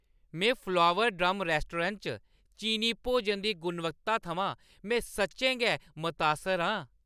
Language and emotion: Dogri, happy